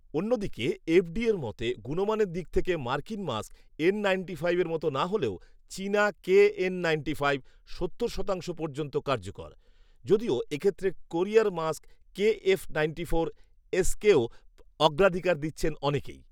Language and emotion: Bengali, neutral